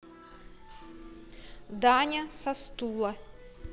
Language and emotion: Russian, neutral